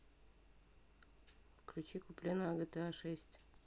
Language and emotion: Russian, neutral